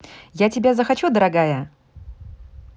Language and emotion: Russian, positive